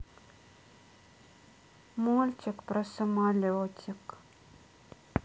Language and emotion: Russian, sad